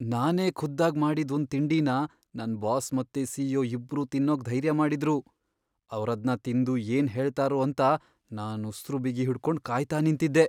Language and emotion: Kannada, fearful